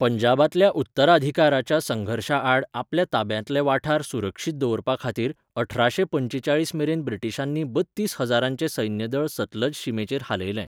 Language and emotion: Goan Konkani, neutral